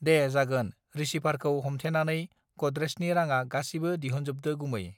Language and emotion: Bodo, neutral